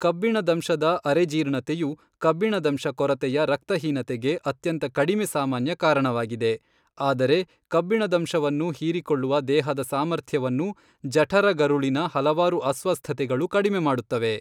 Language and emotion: Kannada, neutral